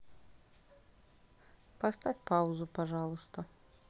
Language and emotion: Russian, neutral